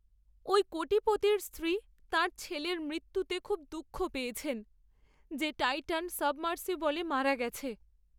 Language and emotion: Bengali, sad